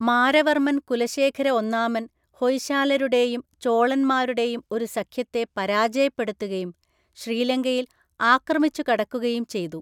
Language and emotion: Malayalam, neutral